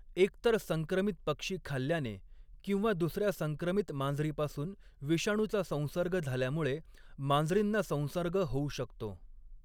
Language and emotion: Marathi, neutral